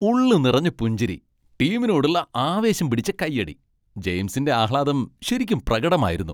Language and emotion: Malayalam, happy